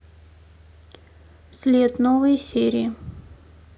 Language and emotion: Russian, neutral